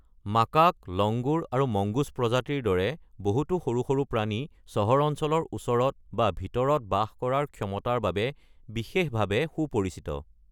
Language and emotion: Assamese, neutral